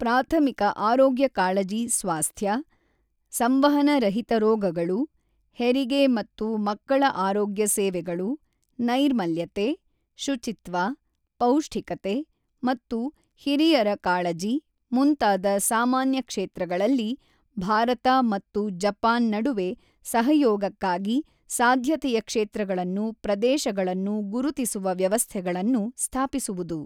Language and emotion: Kannada, neutral